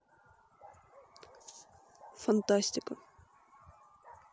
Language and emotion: Russian, neutral